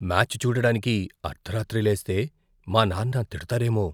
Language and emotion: Telugu, fearful